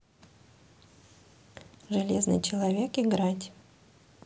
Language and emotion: Russian, neutral